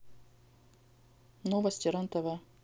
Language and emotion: Russian, neutral